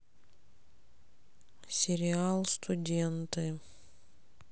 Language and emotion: Russian, sad